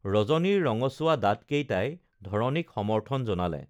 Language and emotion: Assamese, neutral